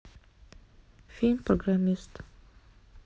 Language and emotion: Russian, neutral